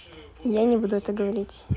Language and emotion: Russian, neutral